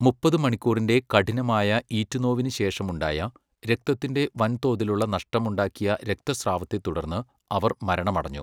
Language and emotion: Malayalam, neutral